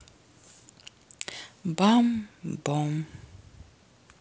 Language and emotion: Russian, neutral